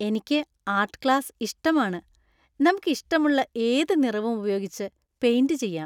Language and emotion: Malayalam, happy